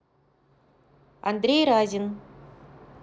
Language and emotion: Russian, neutral